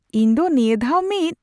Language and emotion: Santali, surprised